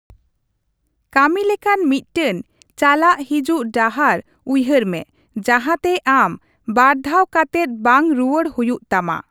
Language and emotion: Santali, neutral